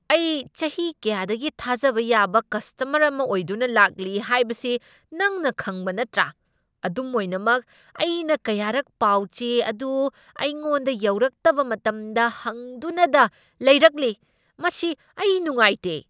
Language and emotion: Manipuri, angry